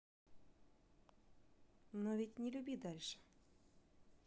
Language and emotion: Russian, neutral